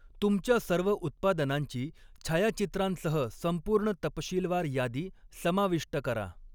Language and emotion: Marathi, neutral